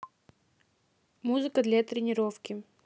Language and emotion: Russian, neutral